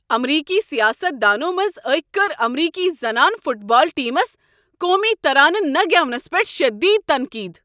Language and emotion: Kashmiri, angry